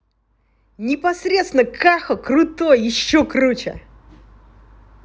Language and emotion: Russian, positive